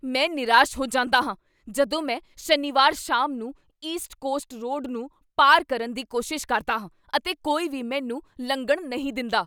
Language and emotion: Punjabi, angry